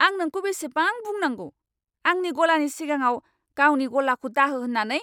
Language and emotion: Bodo, angry